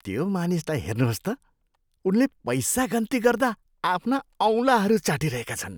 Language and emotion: Nepali, disgusted